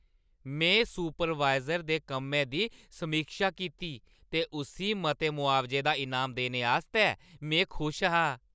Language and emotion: Dogri, happy